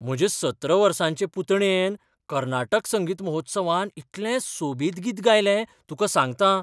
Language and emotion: Goan Konkani, surprised